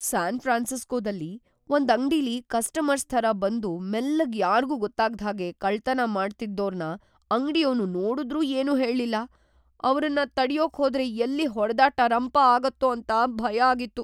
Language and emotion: Kannada, fearful